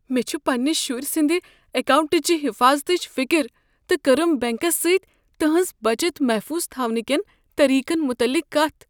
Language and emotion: Kashmiri, fearful